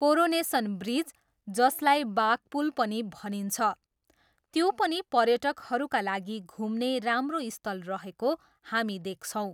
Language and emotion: Nepali, neutral